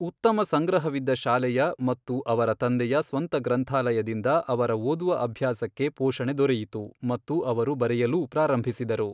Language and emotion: Kannada, neutral